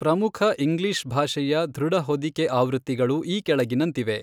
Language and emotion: Kannada, neutral